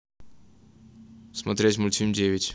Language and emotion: Russian, neutral